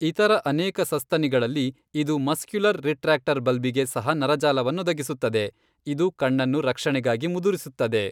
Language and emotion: Kannada, neutral